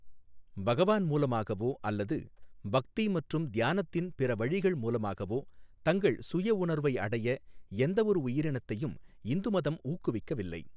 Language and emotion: Tamil, neutral